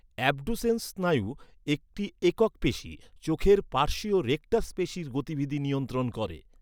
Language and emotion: Bengali, neutral